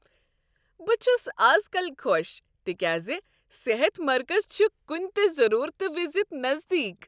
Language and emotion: Kashmiri, happy